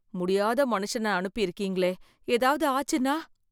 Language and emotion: Tamil, fearful